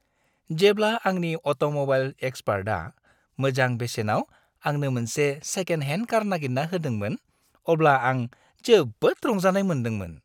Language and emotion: Bodo, happy